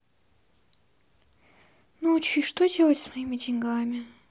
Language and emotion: Russian, sad